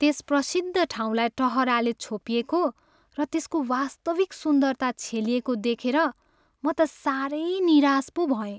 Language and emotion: Nepali, sad